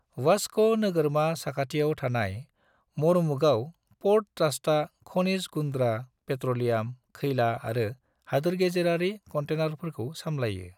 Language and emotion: Bodo, neutral